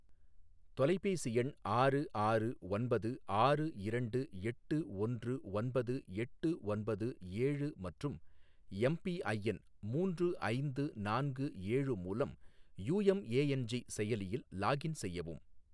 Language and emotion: Tamil, neutral